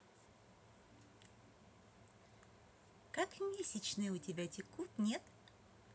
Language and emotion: Russian, positive